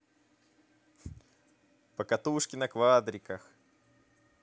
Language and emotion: Russian, positive